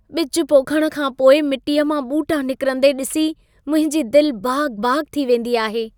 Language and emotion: Sindhi, happy